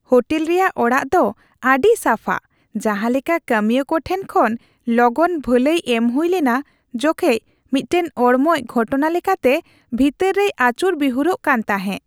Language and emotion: Santali, happy